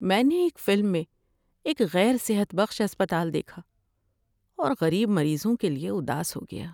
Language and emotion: Urdu, sad